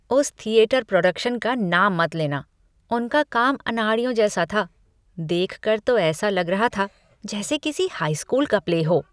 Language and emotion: Hindi, disgusted